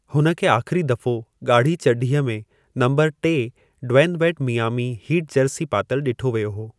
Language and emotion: Sindhi, neutral